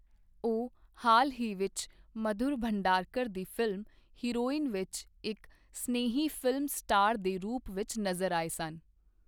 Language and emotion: Punjabi, neutral